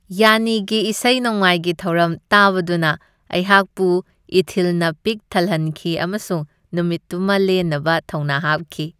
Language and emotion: Manipuri, happy